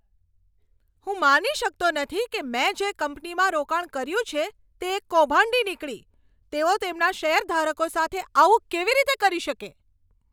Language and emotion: Gujarati, angry